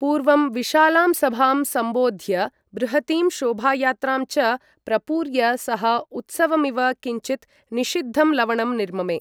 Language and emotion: Sanskrit, neutral